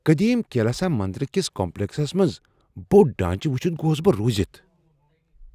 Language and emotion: Kashmiri, surprised